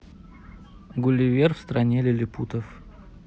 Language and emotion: Russian, neutral